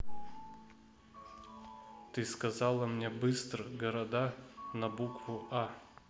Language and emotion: Russian, neutral